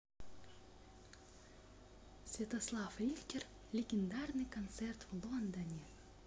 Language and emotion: Russian, positive